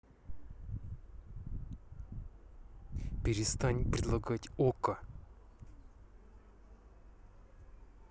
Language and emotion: Russian, angry